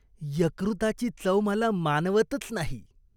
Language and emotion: Marathi, disgusted